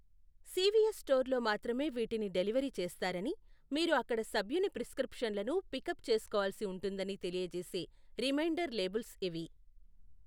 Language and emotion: Telugu, neutral